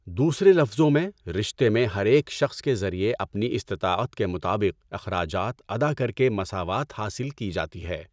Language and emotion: Urdu, neutral